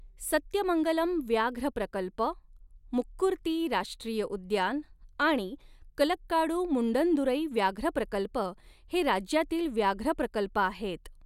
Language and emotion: Marathi, neutral